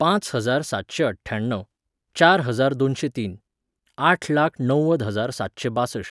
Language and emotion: Goan Konkani, neutral